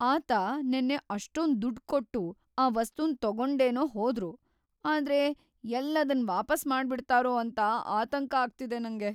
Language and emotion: Kannada, fearful